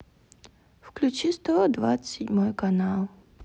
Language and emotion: Russian, sad